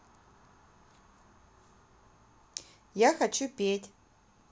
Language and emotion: Russian, neutral